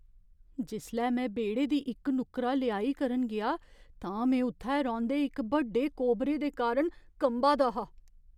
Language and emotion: Dogri, fearful